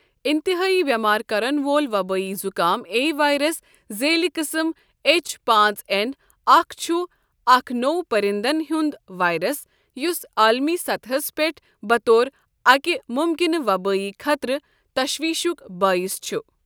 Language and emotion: Kashmiri, neutral